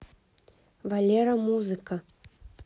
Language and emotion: Russian, neutral